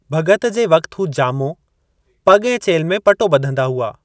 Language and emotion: Sindhi, neutral